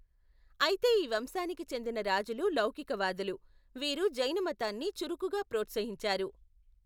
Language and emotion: Telugu, neutral